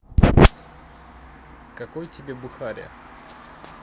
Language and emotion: Russian, neutral